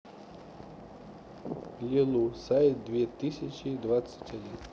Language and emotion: Russian, neutral